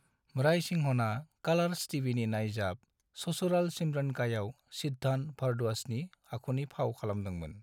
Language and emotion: Bodo, neutral